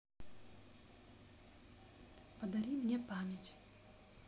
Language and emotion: Russian, neutral